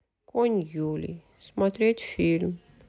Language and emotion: Russian, sad